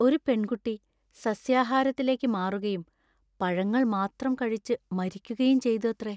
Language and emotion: Malayalam, sad